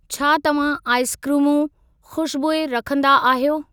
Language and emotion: Sindhi, neutral